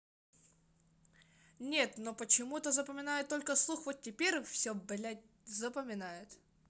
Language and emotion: Russian, angry